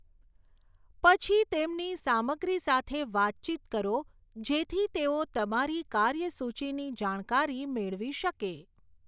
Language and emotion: Gujarati, neutral